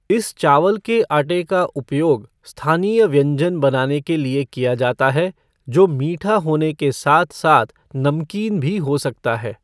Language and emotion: Hindi, neutral